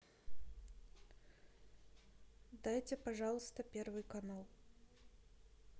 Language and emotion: Russian, neutral